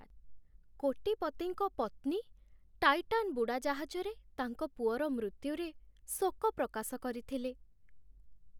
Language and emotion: Odia, sad